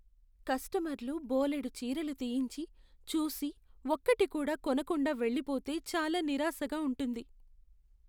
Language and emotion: Telugu, sad